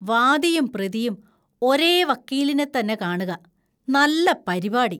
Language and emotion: Malayalam, disgusted